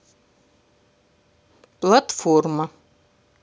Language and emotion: Russian, neutral